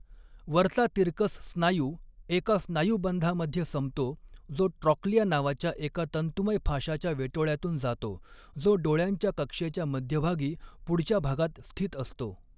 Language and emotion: Marathi, neutral